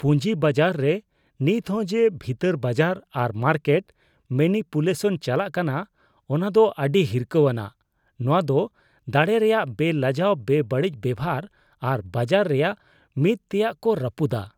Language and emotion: Santali, disgusted